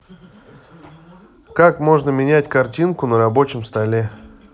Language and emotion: Russian, neutral